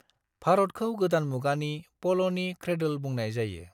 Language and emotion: Bodo, neutral